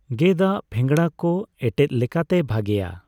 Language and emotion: Santali, neutral